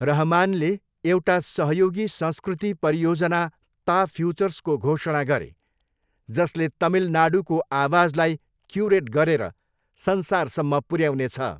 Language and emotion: Nepali, neutral